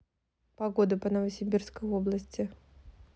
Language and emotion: Russian, neutral